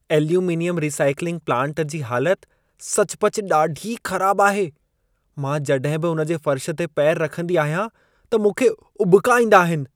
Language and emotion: Sindhi, disgusted